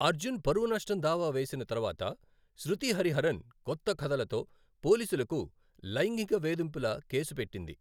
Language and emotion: Telugu, neutral